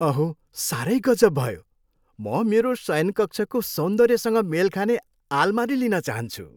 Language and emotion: Nepali, happy